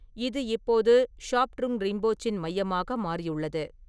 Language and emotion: Tamil, neutral